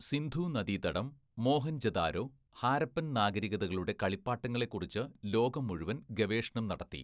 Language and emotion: Malayalam, neutral